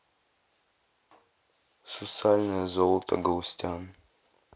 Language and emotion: Russian, neutral